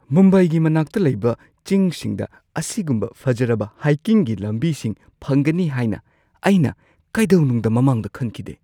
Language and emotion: Manipuri, surprised